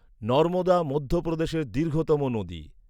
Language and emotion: Bengali, neutral